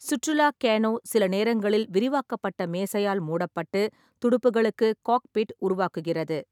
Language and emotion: Tamil, neutral